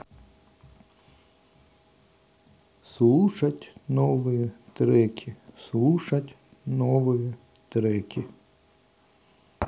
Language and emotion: Russian, neutral